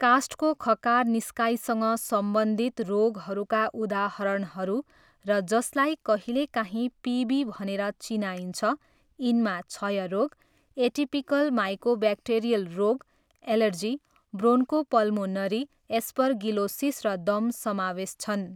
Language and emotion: Nepali, neutral